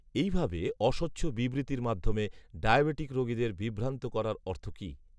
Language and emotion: Bengali, neutral